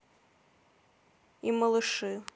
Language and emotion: Russian, neutral